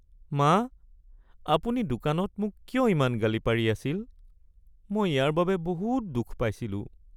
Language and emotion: Assamese, sad